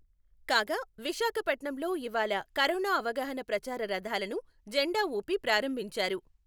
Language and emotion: Telugu, neutral